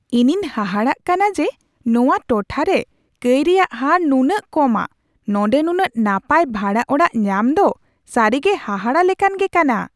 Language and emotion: Santali, surprised